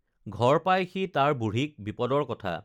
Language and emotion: Assamese, neutral